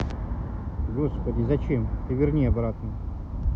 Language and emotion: Russian, neutral